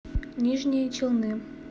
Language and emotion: Russian, neutral